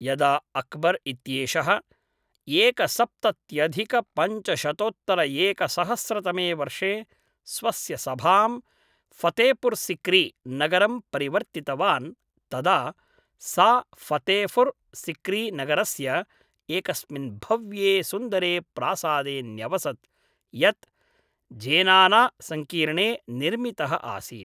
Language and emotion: Sanskrit, neutral